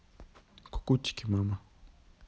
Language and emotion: Russian, neutral